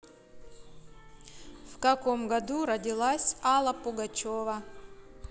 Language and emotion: Russian, neutral